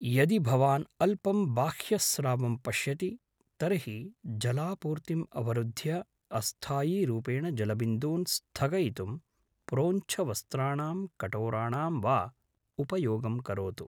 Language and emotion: Sanskrit, neutral